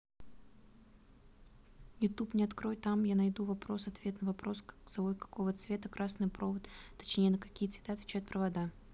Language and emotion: Russian, neutral